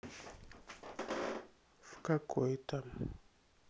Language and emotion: Russian, sad